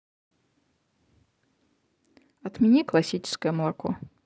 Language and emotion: Russian, neutral